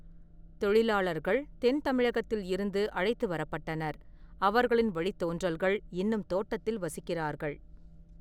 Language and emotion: Tamil, neutral